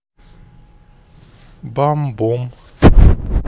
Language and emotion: Russian, neutral